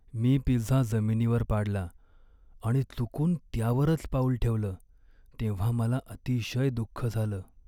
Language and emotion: Marathi, sad